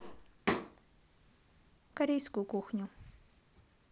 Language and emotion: Russian, neutral